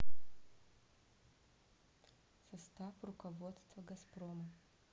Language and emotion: Russian, neutral